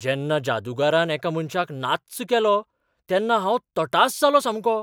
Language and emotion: Goan Konkani, surprised